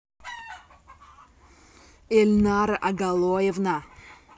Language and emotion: Russian, angry